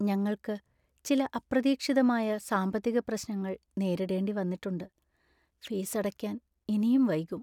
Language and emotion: Malayalam, sad